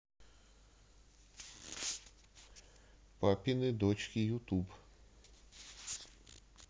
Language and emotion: Russian, neutral